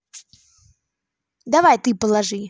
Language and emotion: Russian, positive